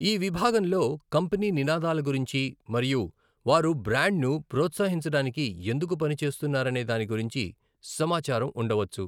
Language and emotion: Telugu, neutral